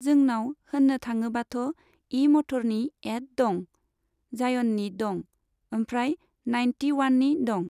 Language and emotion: Bodo, neutral